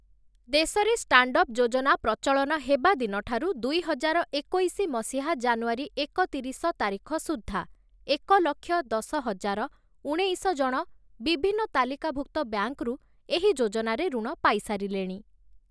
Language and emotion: Odia, neutral